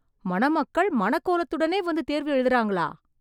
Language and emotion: Tamil, surprised